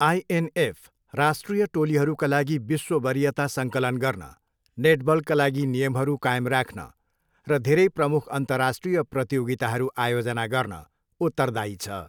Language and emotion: Nepali, neutral